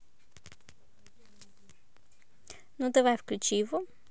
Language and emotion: Russian, positive